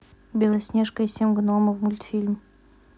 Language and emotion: Russian, neutral